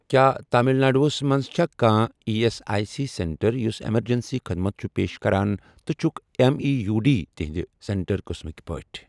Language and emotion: Kashmiri, neutral